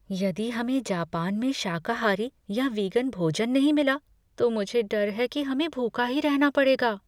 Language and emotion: Hindi, fearful